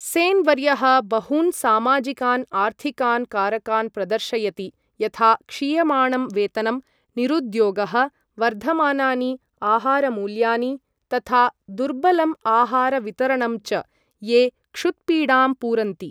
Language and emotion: Sanskrit, neutral